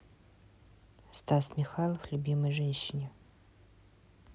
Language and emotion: Russian, neutral